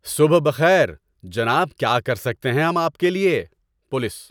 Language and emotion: Urdu, happy